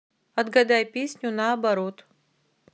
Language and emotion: Russian, neutral